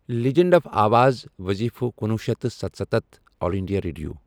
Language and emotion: Kashmiri, neutral